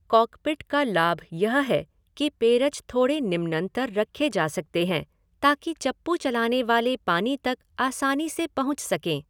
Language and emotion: Hindi, neutral